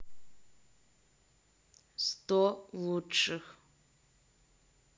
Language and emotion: Russian, neutral